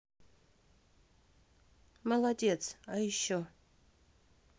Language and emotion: Russian, neutral